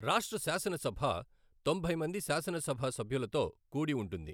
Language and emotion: Telugu, neutral